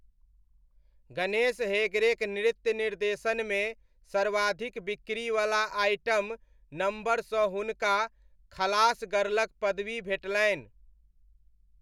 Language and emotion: Maithili, neutral